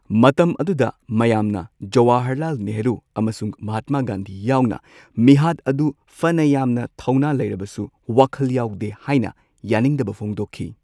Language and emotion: Manipuri, neutral